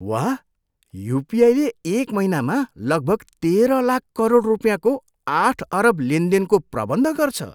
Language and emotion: Nepali, surprised